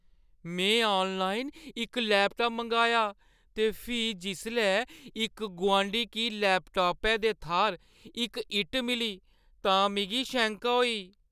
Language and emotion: Dogri, fearful